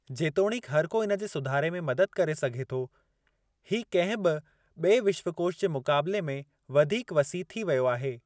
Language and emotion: Sindhi, neutral